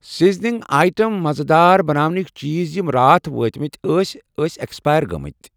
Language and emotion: Kashmiri, neutral